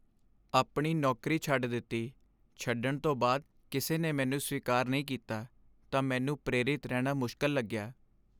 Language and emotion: Punjabi, sad